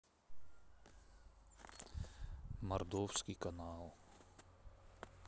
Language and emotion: Russian, sad